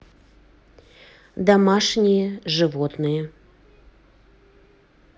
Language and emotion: Russian, neutral